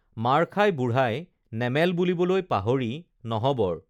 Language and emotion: Assamese, neutral